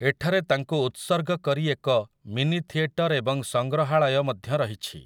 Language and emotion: Odia, neutral